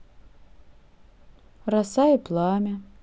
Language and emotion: Russian, neutral